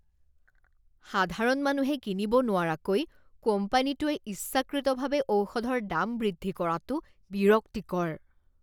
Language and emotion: Assamese, disgusted